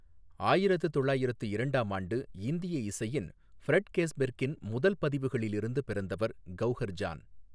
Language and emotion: Tamil, neutral